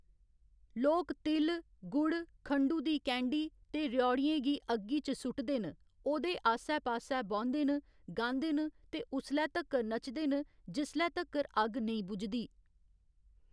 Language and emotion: Dogri, neutral